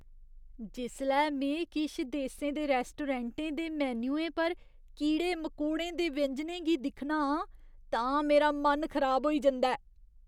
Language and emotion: Dogri, disgusted